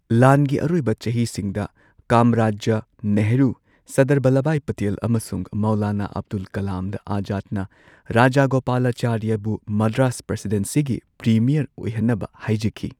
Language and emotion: Manipuri, neutral